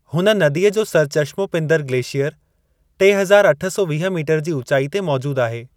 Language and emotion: Sindhi, neutral